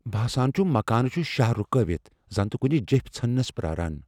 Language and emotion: Kashmiri, fearful